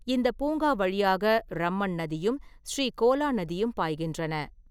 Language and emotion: Tamil, neutral